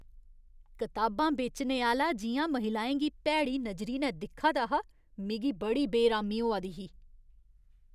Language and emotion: Dogri, disgusted